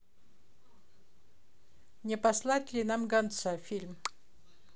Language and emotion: Russian, neutral